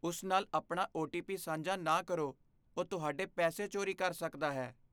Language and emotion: Punjabi, fearful